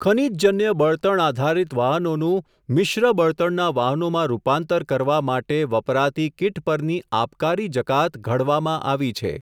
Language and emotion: Gujarati, neutral